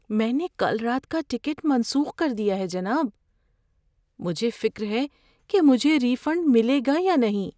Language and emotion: Urdu, fearful